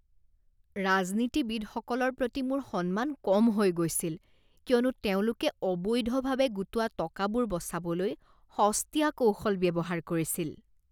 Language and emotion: Assamese, disgusted